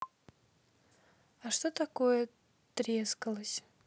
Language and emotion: Russian, neutral